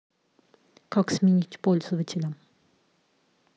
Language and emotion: Russian, neutral